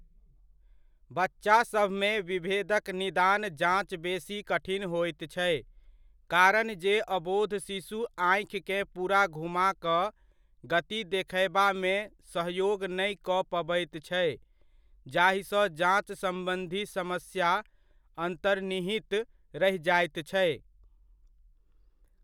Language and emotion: Maithili, neutral